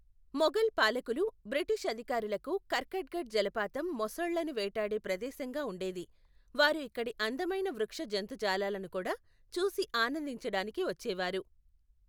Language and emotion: Telugu, neutral